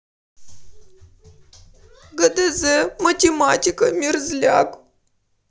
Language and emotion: Russian, sad